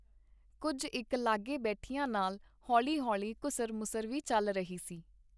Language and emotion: Punjabi, neutral